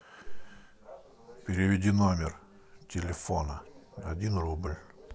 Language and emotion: Russian, neutral